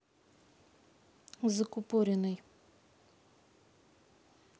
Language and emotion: Russian, neutral